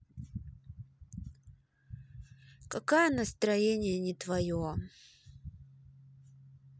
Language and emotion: Russian, sad